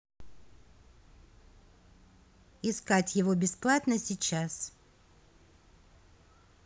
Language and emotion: Russian, neutral